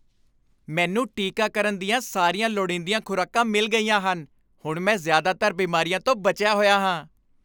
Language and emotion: Punjabi, happy